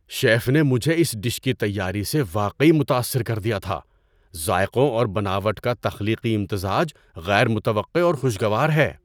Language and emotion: Urdu, surprised